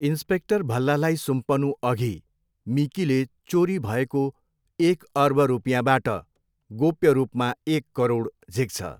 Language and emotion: Nepali, neutral